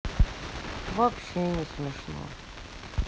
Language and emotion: Russian, sad